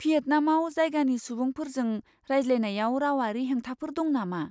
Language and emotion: Bodo, fearful